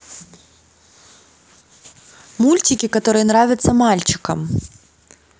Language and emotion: Russian, positive